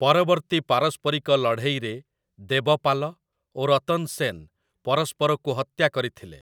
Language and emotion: Odia, neutral